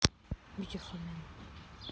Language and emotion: Russian, neutral